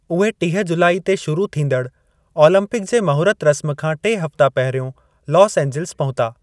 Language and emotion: Sindhi, neutral